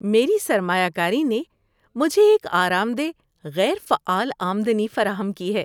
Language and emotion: Urdu, happy